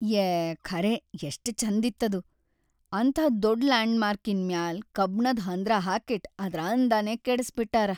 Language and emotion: Kannada, sad